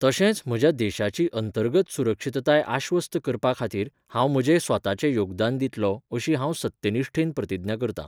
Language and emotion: Goan Konkani, neutral